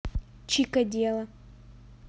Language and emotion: Russian, neutral